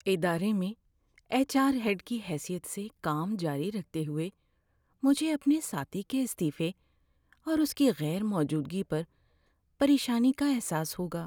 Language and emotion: Urdu, sad